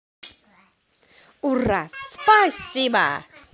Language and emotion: Russian, positive